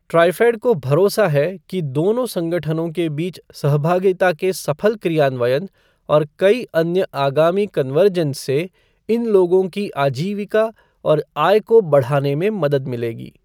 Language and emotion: Hindi, neutral